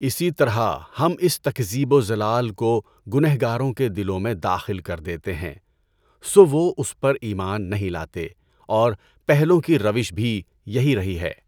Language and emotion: Urdu, neutral